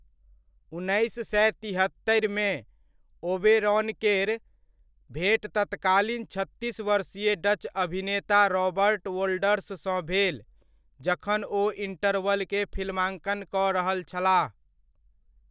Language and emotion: Maithili, neutral